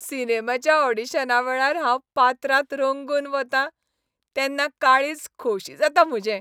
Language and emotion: Goan Konkani, happy